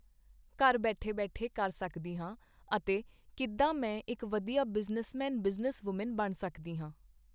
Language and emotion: Punjabi, neutral